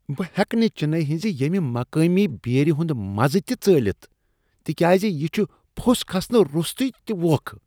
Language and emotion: Kashmiri, disgusted